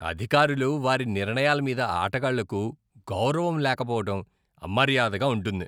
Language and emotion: Telugu, disgusted